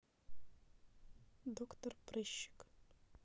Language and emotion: Russian, neutral